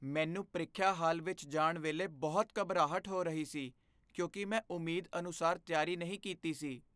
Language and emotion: Punjabi, fearful